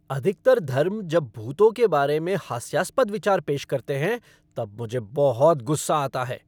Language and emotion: Hindi, angry